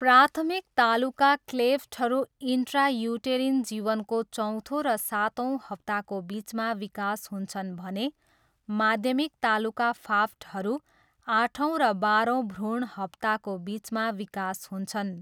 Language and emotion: Nepali, neutral